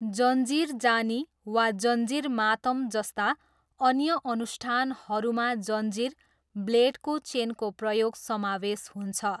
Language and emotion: Nepali, neutral